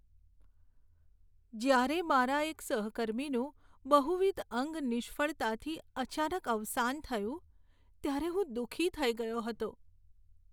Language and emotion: Gujarati, sad